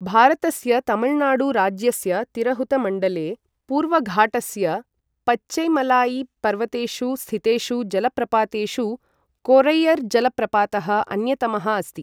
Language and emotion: Sanskrit, neutral